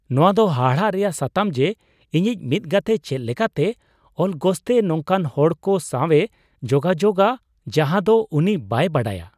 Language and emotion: Santali, surprised